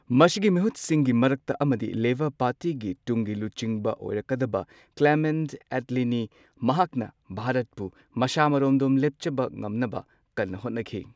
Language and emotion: Manipuri, neutral